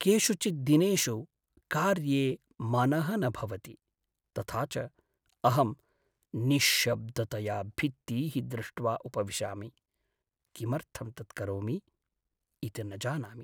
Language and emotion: Sanskrit, sad